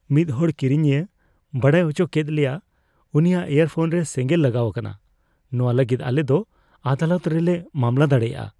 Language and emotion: Santali, fearful